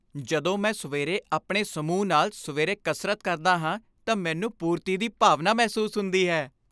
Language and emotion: Punjabi, happy